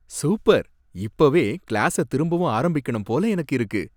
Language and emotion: Tamil, happy